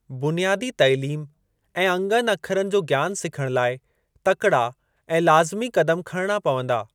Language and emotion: Sindhi, neutral